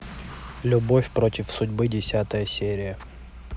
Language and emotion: Russian, neutral